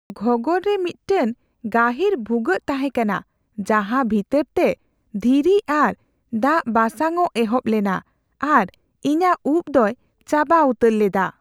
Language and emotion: Santali, fearful